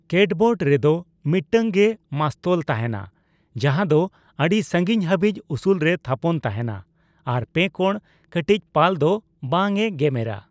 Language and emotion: Santali, neutral